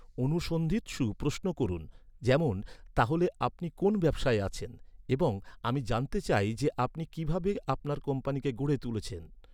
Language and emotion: Bengali, neutral